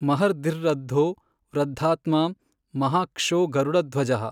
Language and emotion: Kannada, neutral